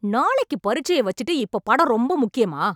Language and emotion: Tamil, angry